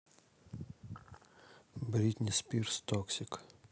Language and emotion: Russian, neutral